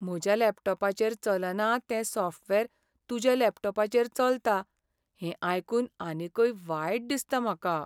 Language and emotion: Goan Konkani, sad